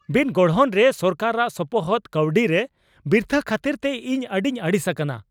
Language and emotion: Santali, angry